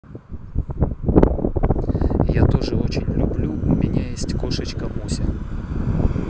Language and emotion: Russian, neutral